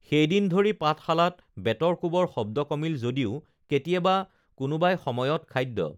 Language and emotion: Assamese, neutral